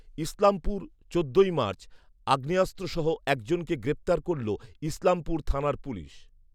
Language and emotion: Bengali, neutral